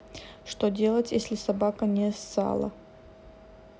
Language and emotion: Russian, neutral